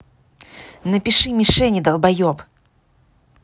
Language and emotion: Russian, angry